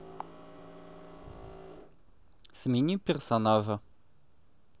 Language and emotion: Russian, neutral